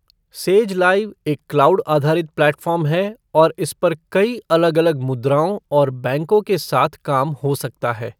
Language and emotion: Hindi, neutral